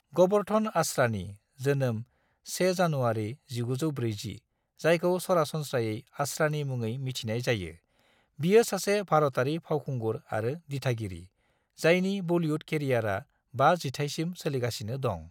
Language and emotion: Bodo, neutral